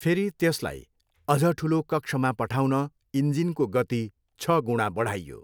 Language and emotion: Nepali, neutral